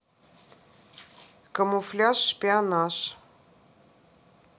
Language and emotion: Russian, neutral